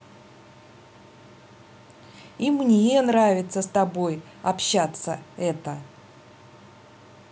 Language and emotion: Russian, positive